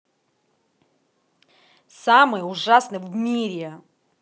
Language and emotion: Russian, angry